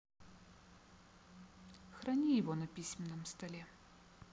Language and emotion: Russian, neutral